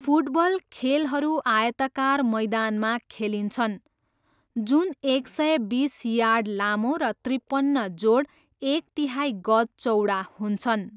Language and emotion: Nepali, neutral